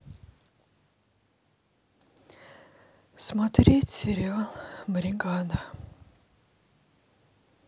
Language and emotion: Russian, sad